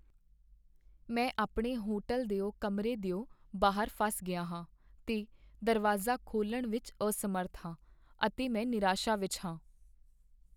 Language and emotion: Punjabi, sad